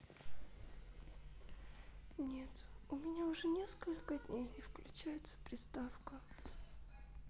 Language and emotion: Russian, sad